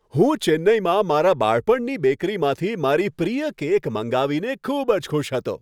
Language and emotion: Gujarati, happy